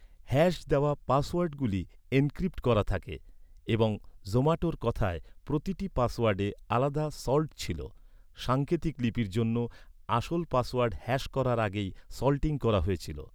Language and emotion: Bengali, neutral